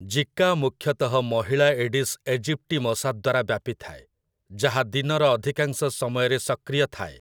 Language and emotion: Odia, neutral